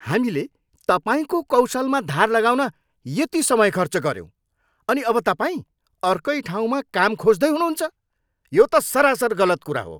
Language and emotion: Nepali, angry